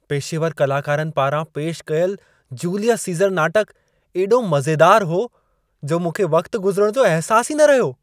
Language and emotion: Sindhi, happy